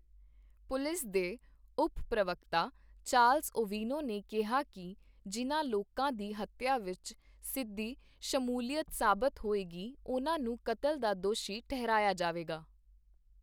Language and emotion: Punjabi, neutral